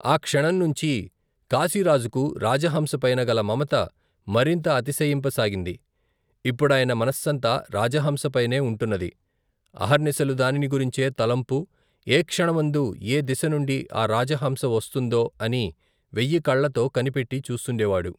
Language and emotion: Telugu, neutral